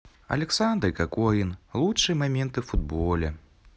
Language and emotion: Russian, neutral